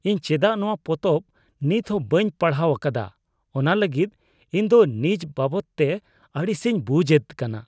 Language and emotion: Santali, disgusted